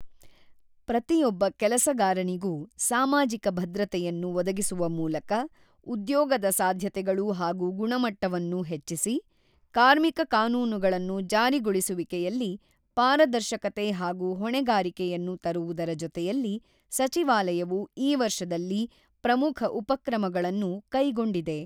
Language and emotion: Kannada, neutral